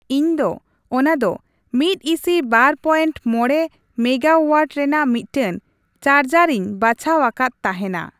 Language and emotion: Santali, neutral